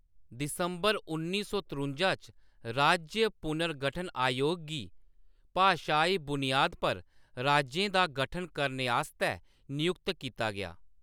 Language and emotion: Dogri, neutral